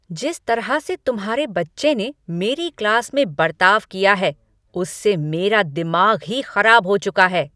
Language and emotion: Hindi, angry